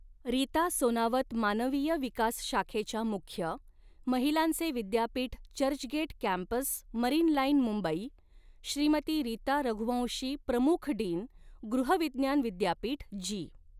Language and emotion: Marathi, neutral